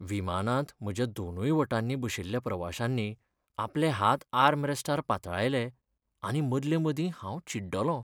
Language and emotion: Goan Konkani, sad